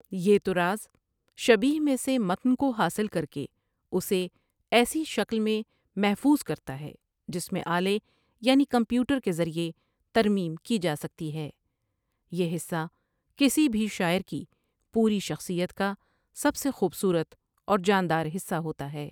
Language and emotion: Urdu, neutral